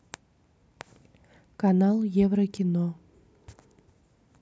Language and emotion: Russian, neutral